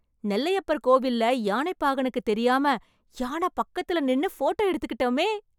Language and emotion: Tamil, happy